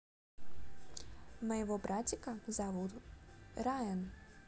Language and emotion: Russian, positive